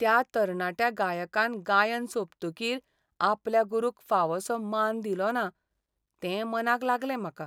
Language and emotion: Goan Konkani, sad